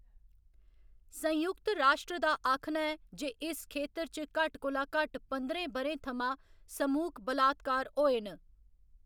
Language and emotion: Dogri, neutral